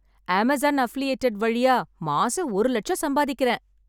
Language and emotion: Tamil, happy